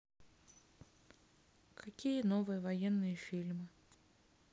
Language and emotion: Russian, neutral